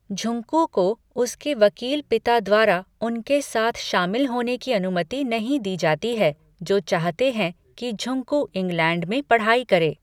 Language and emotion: Hindi, neutral